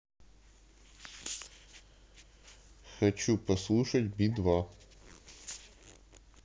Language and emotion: Russian, neutral